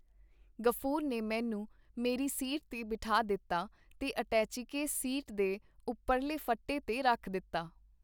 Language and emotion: Punjabi, neutral